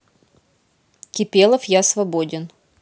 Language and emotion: Russian, neutral